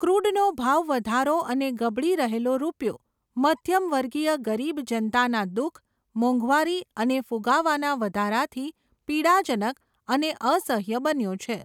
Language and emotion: Gujarati, neutral